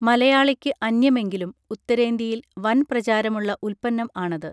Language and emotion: Malayalam, neutral